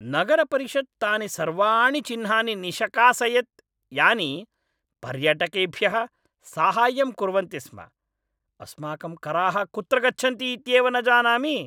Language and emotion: Sanskrit, angry